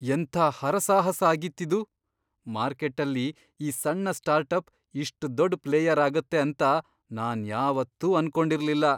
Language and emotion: Kannada, surprised